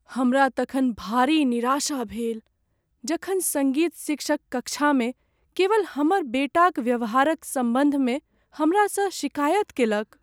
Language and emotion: Maithili, sad